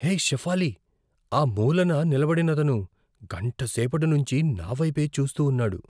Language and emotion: Telugu, fearful